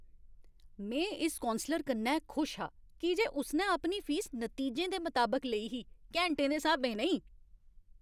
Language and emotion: Dogri, happy